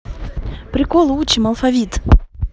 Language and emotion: Russian, positive